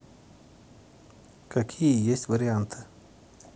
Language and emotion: Russian, neutral